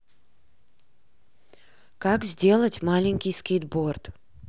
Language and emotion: Russian, neutral